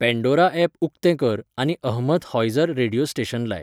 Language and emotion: Goan Konkani, neutral